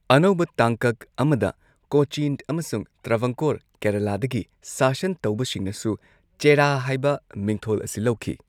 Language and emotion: Manipuri, neutral